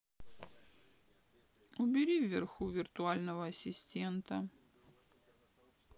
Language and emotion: Russian, sad